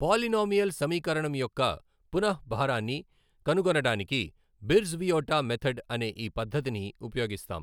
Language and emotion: Telugu, neutral